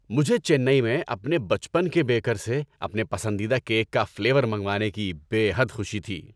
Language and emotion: Urdu, happy